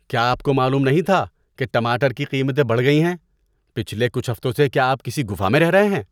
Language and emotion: Urdu, disgusted